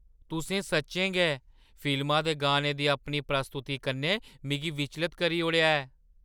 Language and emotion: Dogri, surprised